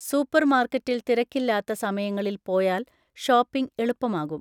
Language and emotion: Malayalam, neutral